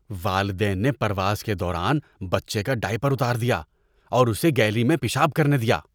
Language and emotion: Urdu, disgusted